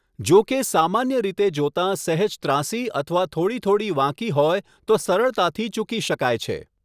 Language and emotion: Gujarati, neutral